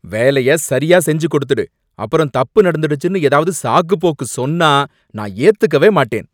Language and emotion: Tamil, angry